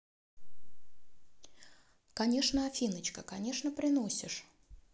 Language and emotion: Russian, positive